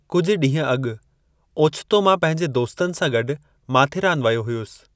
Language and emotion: Sindhi, neutral